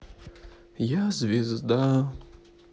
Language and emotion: Russian, sad